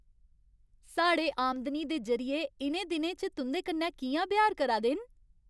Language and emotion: Dogri, happy